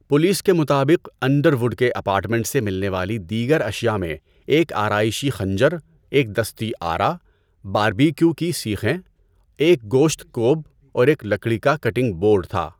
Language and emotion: Urdu, neutral